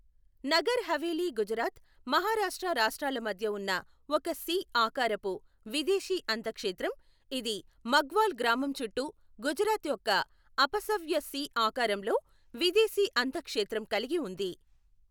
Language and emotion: Telugu, neutral